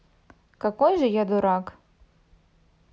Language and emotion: Russian, neutral